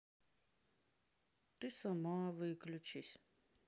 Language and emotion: Russian, sad